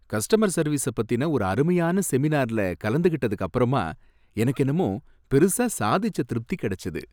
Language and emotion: Tamil, happy